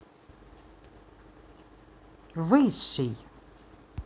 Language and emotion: Russian, neutral